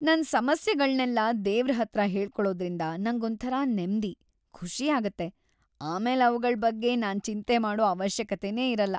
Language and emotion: Kannada, happy